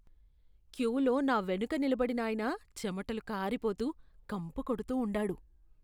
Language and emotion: Telugu, disgusted